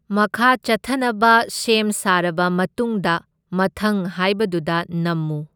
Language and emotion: Manipuri, neutral